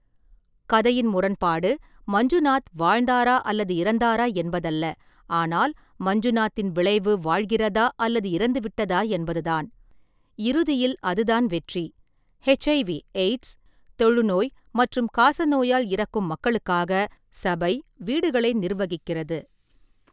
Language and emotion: Tamil, neutral